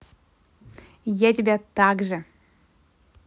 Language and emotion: Russian, positive